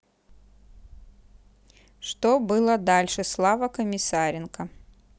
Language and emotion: Russian, neutral